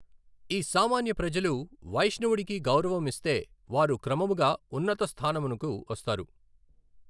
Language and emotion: Telugu, neutral